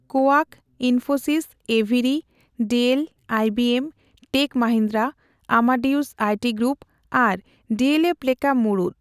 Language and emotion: Santali, neutral